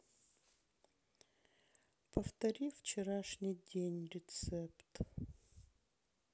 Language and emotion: Russian, sad